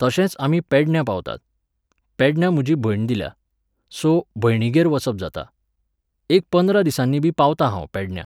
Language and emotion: Goan Konkani, neutral